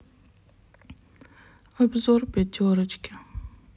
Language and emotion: Russian, sad